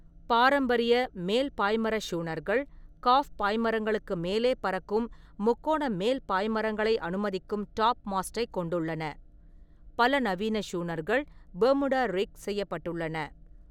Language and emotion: Tamil, neutral